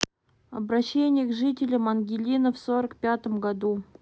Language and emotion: Russian, neutral